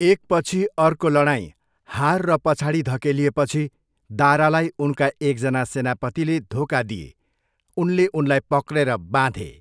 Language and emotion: Nepali, neutral